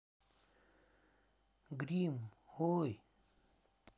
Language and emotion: Russian, neutral